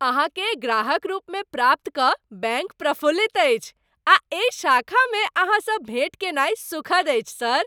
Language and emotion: Maithili, happy